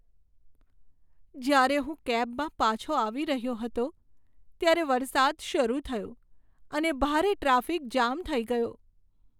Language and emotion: Gujarati, sad